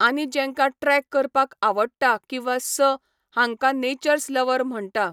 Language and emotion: Goan Konkani, neutral